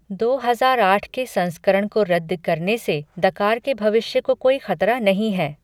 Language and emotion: Hindi, neutral